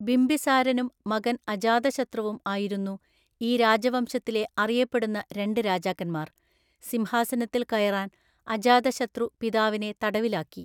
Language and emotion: Malayalam, neutral